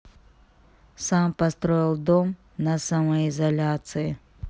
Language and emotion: Russian, neutral